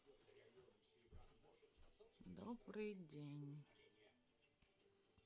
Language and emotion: Russian, sad